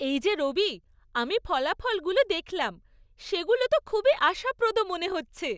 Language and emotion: Bengali, happy